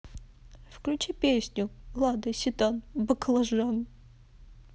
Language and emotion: Russian, sad